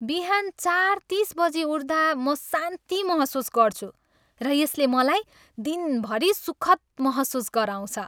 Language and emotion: Nepali, happy